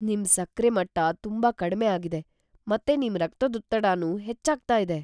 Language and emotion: Kannada, fearful